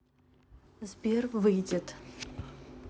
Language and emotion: Russian, neutral